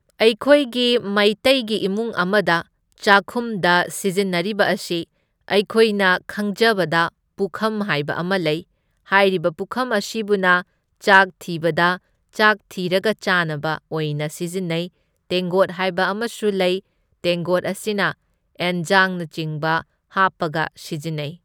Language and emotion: Manipuri, neutral